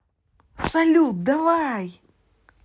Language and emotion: Russian, positive